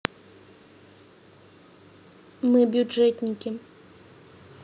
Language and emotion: Russian, neutral